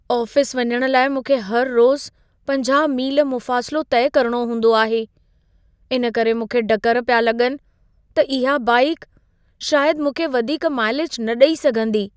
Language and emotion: Sindhi, fearful